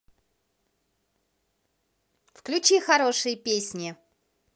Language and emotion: Russian, positive